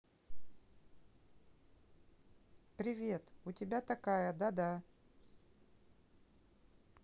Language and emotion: Russian, neutral